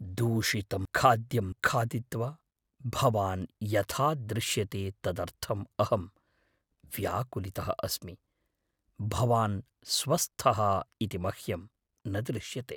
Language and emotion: Sanskrit, fearful